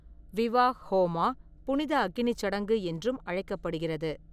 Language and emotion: Tamil, neutral